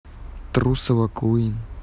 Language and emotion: Russian, neutral